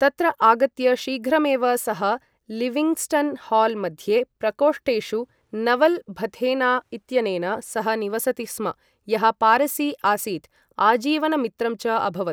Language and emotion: Sanskrit, neutral